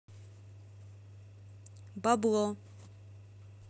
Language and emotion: Russian, neutral